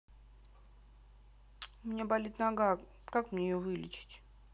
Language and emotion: Russian, neutral